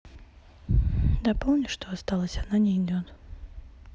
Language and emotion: Russian, sad